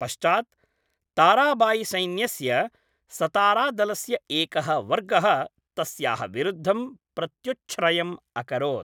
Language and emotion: Sanskrit, neutral